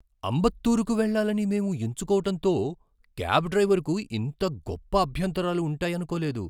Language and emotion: Telugu, surprised